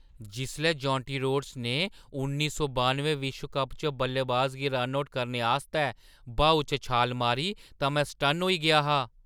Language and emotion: Dogri, surprised